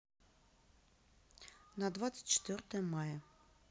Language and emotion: Russian, neutral